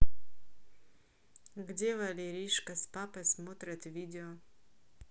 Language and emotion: Russian, neutral